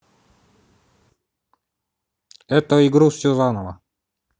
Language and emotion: Russian, neutral